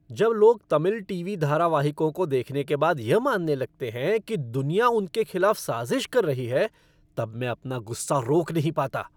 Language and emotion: Hindi, angry